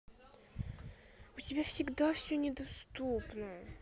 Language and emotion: Russian, sad